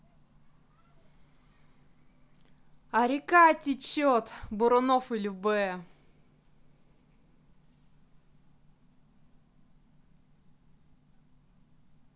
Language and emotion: Russian, positive